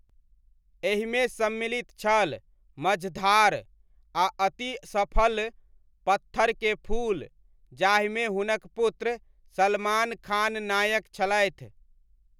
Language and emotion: Maithili, neutral